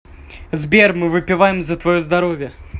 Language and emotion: Russian, positive